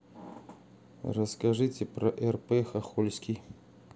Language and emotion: Russian, neutral